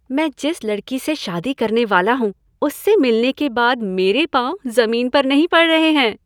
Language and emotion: Hindi, happy